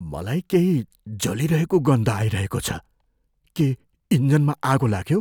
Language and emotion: Nepali, fearful